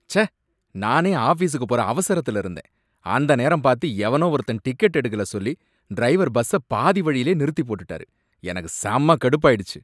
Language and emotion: Tamil, angry